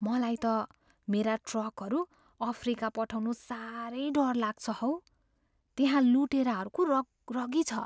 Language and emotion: Nepali, fearful